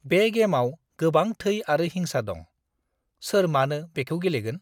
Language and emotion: Bodo, disgusted